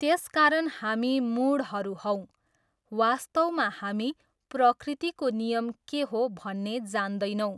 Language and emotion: Nepali, neutral